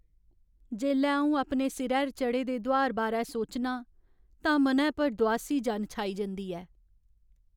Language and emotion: Dogri, sad